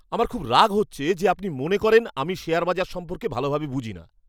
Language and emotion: Bengali, angry